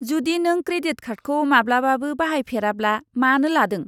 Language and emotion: Bodo, disgusted